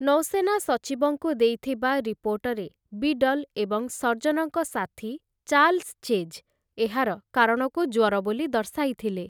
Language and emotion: Odia, neutral